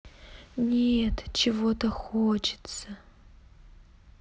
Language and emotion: Russian, sad